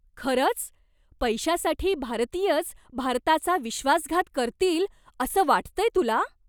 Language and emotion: Marathi, surprised